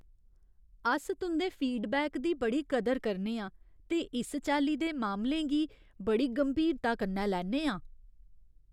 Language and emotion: Dogri, fearful